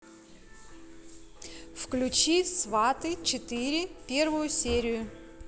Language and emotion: Russian, neutral